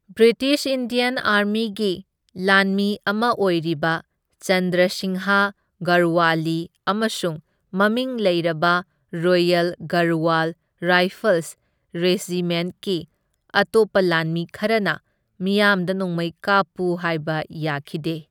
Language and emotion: Manipuri, neutral